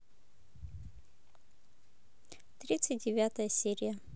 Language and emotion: Russian, neutral